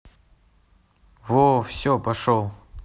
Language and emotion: Russian, neutral